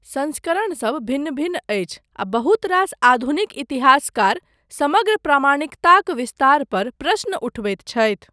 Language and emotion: Maithili, neutral